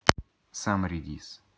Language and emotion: Russian, neutral